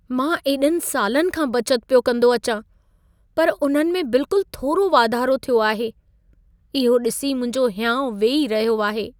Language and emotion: Sindhi, sad